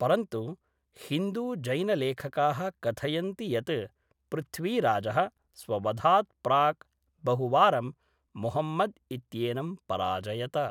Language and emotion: Sanskrit, neutral